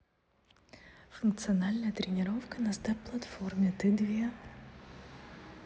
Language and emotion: Russian, neutral